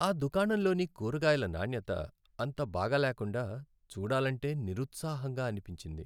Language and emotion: Telugu, sad